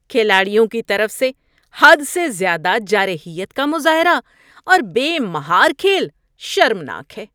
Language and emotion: Urdu, disgusted